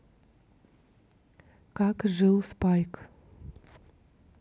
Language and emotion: Russian, neutral